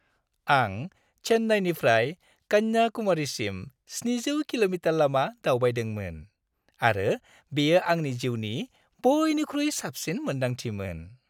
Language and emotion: Bodo, happy